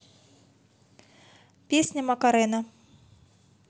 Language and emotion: Russian, neutral